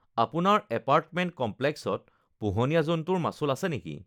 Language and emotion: Assamese, neutral